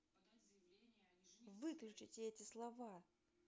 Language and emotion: Russian, angry